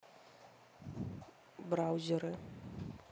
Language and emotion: Russian, neutral